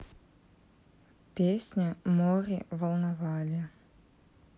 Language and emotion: Russian, neutral